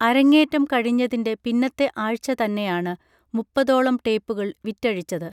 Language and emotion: Malayalam, neutral